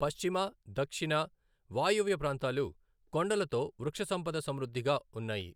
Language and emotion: Telugu, neutral